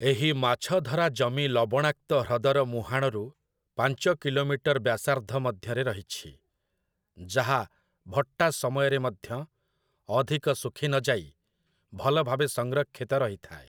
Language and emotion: Odia, neutral